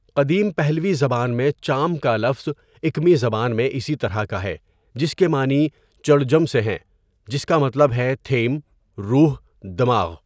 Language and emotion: Urdu, neutral